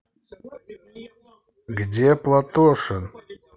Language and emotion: Russian, neutral